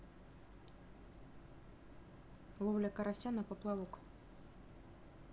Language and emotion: Russian, neutral